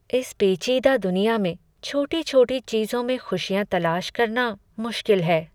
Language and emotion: Hindi, sad